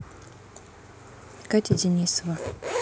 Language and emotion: Russian, neutral